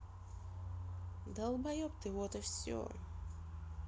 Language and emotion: Russian, neutral